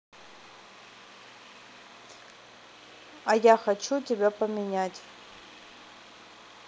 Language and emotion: Russian, neutral